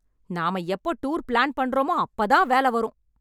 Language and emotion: Tamil, angry